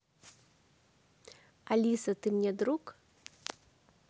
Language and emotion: Russian, neutral